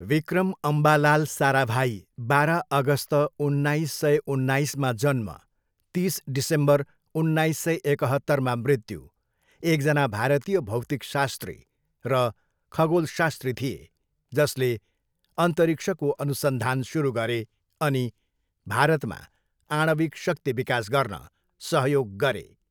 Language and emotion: Nepali, neutral